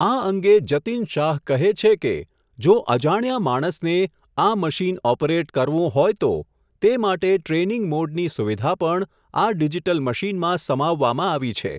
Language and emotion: Gujarati, neutral